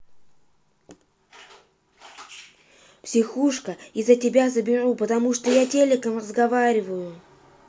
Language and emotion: Russian, angry